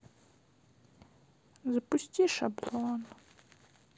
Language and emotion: Russian, sad